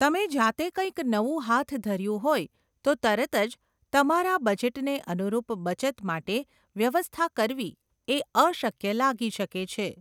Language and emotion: Gujarati, neutral